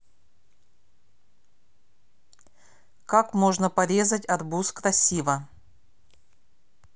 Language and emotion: Russian, neutral